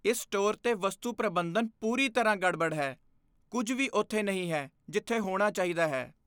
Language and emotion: Punjabi, disgusted